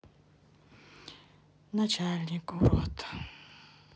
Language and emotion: Russian, sad